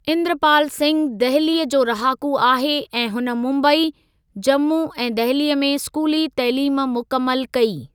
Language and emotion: Sindhi, neutral